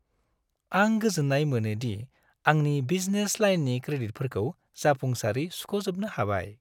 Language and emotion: Bodo, happy